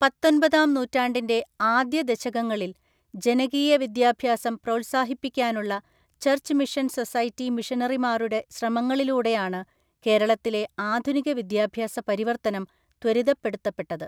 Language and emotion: Malayalam, neutral